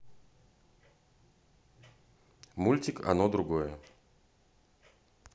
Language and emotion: Russian, neutral